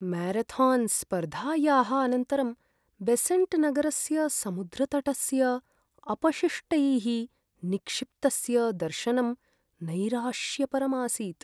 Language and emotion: Sanskrit, sad